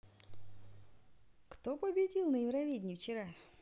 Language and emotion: Russian, positive